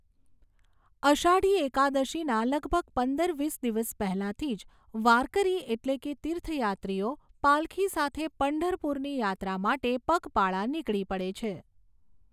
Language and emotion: Gujarati, neutral